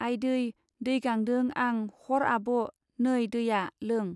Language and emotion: Bodo, neutral